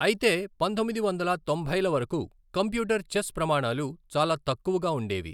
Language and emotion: Telugu, neutral